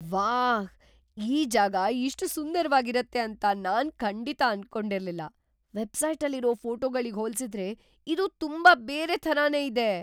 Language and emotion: Kannada, surprised